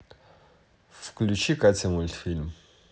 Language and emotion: Russian, neutral